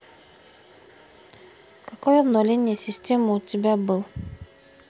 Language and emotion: Russian, neutral